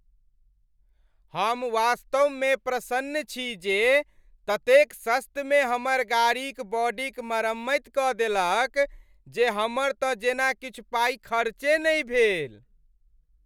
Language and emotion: Maithili, happy